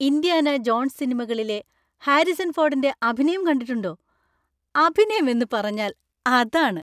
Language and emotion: Malayalam, happy